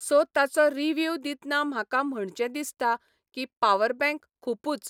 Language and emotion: Goan Konkani, neutral